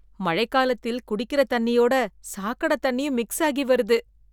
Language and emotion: Tamil, disgusted